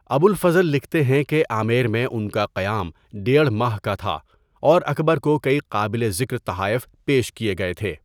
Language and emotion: Urdu, neutral